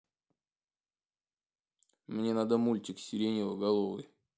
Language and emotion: Russian, neutral